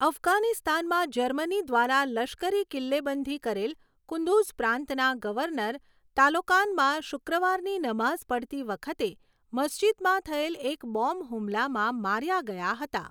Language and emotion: Gujarati, neutral